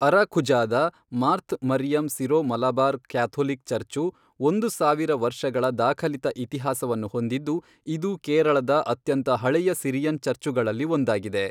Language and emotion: Kannada, neutral